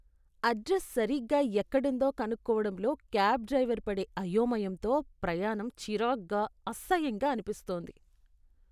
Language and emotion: Telugu, disgusted